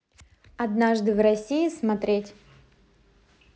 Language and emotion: Russian, positive